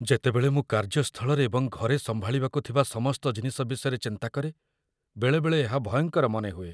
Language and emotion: Odia, fearful